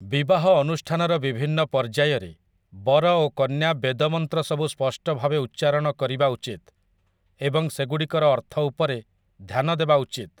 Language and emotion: Odia, neutral